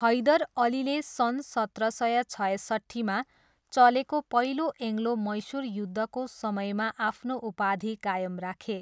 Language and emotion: Nepali, neutral